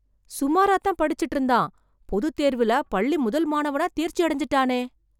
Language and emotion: Tamil, surprised